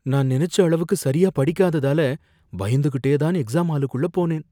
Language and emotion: Tamil, fearful